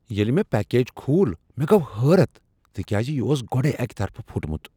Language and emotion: Kashmiri, surprised